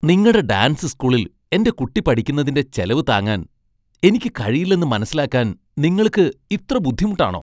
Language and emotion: Malayalam, disgusted